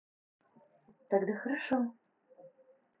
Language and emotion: Russian, positive